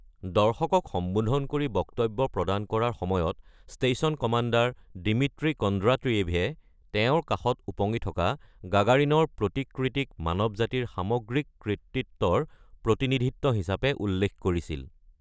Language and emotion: Assamese, neutral